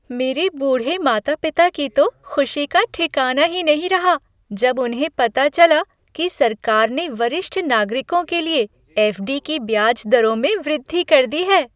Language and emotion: Hindi, happy